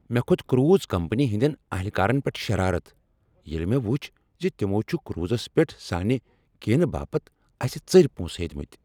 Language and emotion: Kashmiri, angry